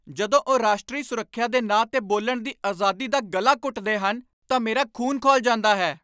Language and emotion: Punjabi, angry